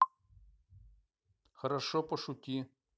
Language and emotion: Russian, neutral